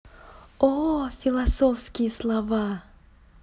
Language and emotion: Russian, positive